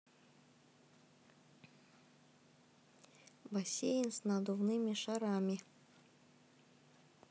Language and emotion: Russian, neutral